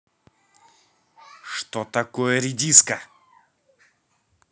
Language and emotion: Russian, angry